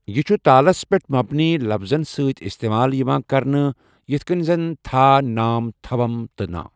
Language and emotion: Kashmiri, neutral